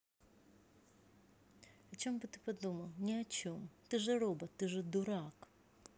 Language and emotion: Russian, neutral